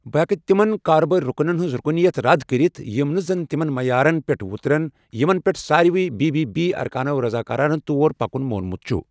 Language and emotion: Kashmiri, neutral